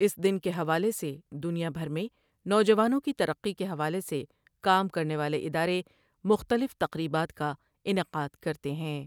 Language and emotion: Urdu, neutral